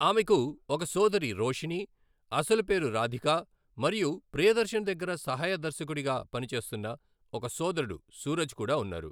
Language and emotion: Telugu, neutral